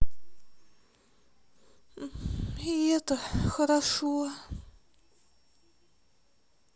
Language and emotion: Russian, sad